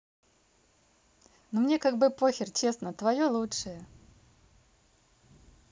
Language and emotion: Russian, neutral